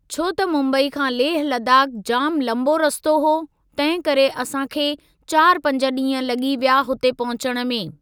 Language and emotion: Sindhi, neutral